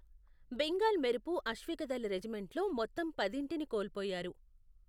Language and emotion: Telugu, neutral